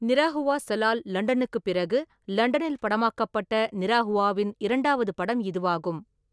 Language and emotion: Tamil, neutral